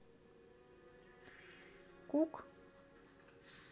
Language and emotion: Russian, neutral